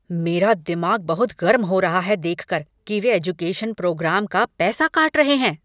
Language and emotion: Hindi, angry